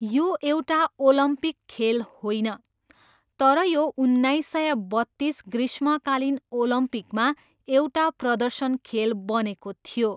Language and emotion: Nepali, neutral